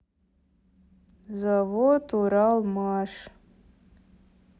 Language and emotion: Russian, neutral